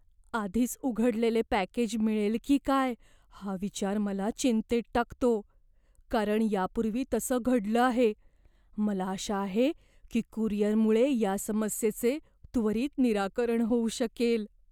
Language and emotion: Marathi, fearful